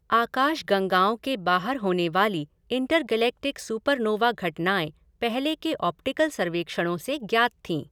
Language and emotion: Hindi, neutral